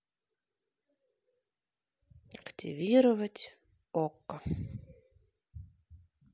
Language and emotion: Russian, neutral